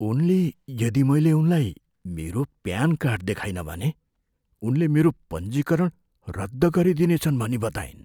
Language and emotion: Nepali, fearful